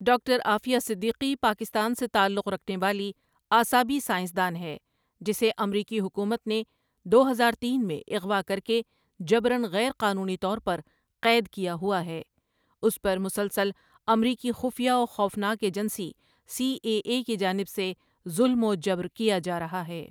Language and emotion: Urdu, neutral